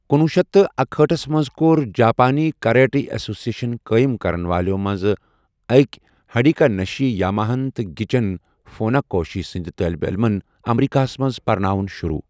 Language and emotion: Kashmiri, neutral